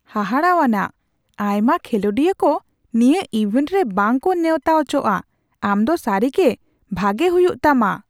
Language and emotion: Santali, surprised